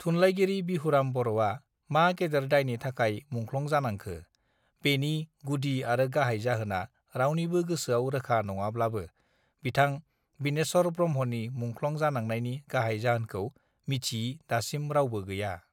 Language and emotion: Bodo, neutral